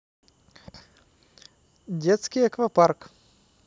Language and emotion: Russian, neutral